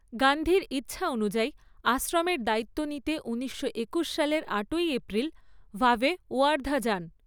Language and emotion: Bengali, neutral